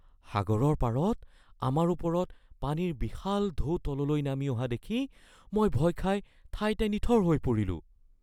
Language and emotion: Assamese, fearful